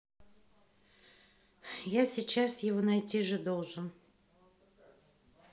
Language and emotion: Russian, neutral